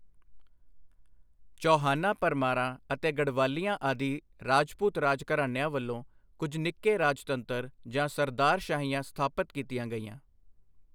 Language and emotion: Punjabi, neutral